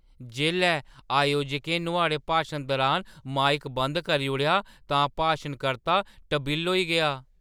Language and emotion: Dogri, surprised